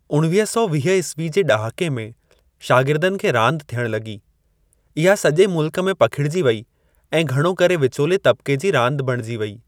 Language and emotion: Sindhi, neutral